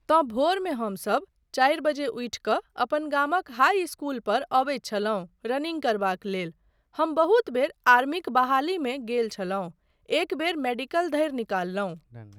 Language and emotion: Maithili, neutral